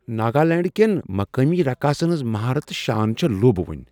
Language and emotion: Kashmiri, surprised